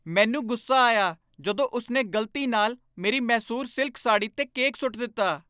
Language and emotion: Punjabi, angry